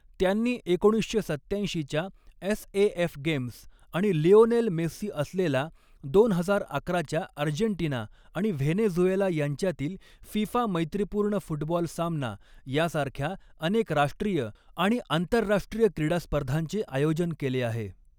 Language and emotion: Marathi, neutral